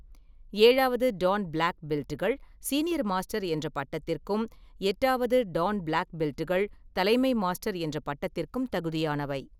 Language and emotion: Tamil, neutral